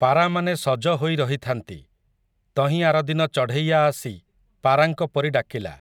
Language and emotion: Odia, neutral